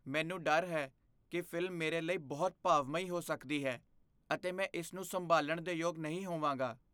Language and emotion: Punjabi, fearful